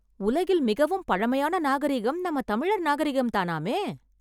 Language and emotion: Tamil, surprised